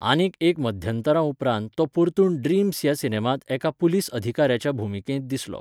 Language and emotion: Goan Konkani, neutral